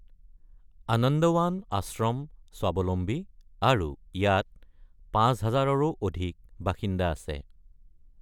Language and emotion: Assamese, neutral